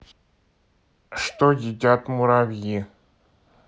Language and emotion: Russian, neutral